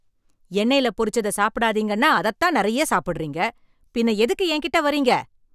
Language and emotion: Tamil, angry